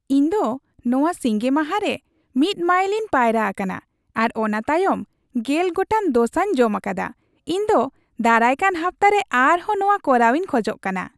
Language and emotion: Santali, happy